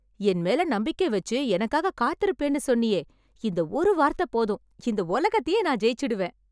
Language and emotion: Tamil, happy